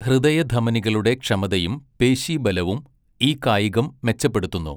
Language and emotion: Malayalam, neutral